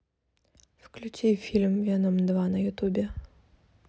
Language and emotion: Russian, neutral